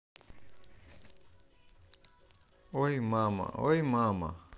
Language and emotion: Russian, neutral